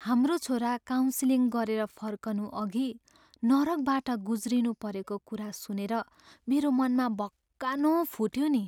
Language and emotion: Nepali, sad